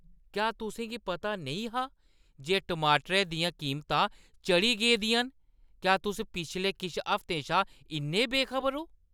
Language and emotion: Dogri, disgusted